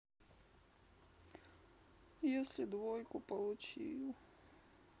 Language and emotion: Russian, sad